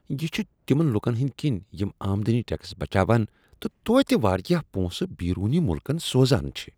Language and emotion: Kashmiri, disgusted